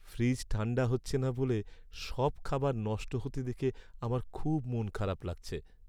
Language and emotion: Bengali, sad